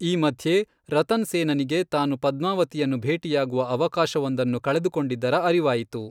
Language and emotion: Kannada, neutral